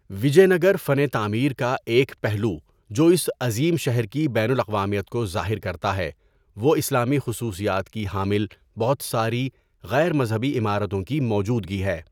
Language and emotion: Urdu, neutral